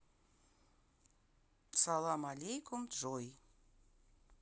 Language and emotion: Russian, neutral